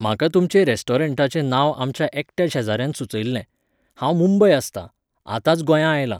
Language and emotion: Goan Konkani, neutral